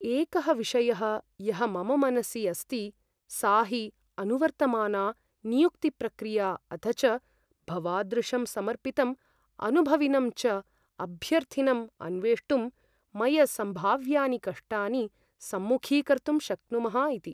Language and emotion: Sanskrit, fearful